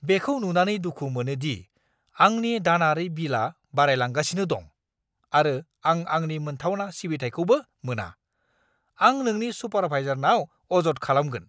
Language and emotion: Bodo, angry